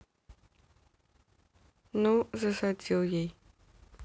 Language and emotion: Russian, neutral